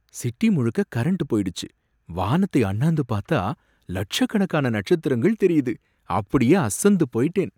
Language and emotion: Tamil, surprised